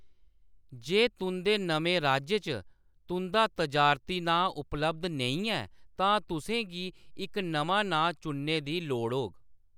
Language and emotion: Dogri, neutral